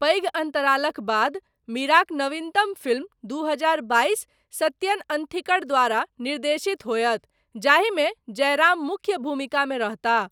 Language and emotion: Maithili, neutral